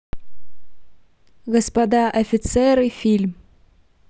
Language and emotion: Russian, neutral